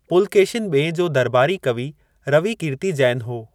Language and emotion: Sindhi, neutral